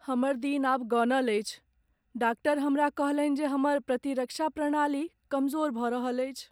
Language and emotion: Maithili, sad